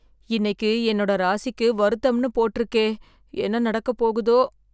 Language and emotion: Tamil, fearful